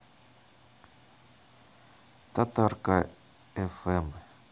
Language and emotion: Russian, neutral